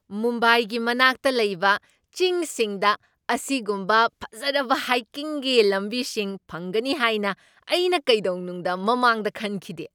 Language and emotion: Manipuri, surprised